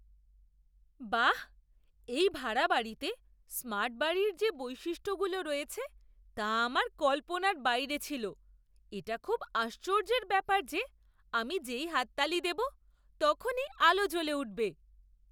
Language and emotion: Bengali, surprised